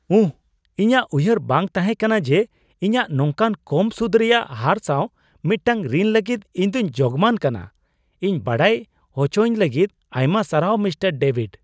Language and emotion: Santali, surprised